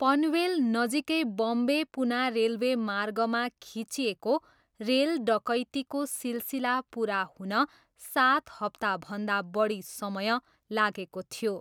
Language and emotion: Nepali, neutral